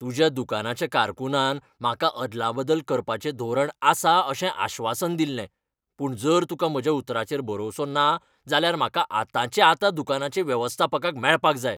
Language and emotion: Goan Konkani, angry